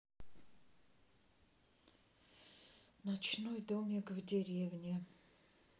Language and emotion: Russian, sad